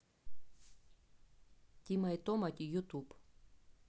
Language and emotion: Russian, neutral